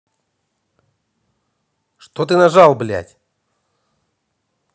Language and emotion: Russian, angry